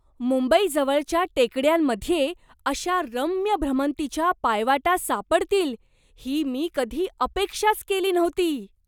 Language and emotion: Marathi, surprised